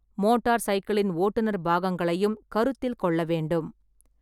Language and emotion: Tamil, neutral